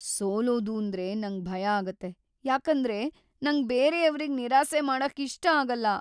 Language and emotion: Kannada, fearful